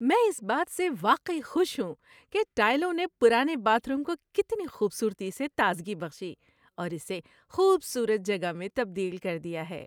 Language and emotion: Urdu, happy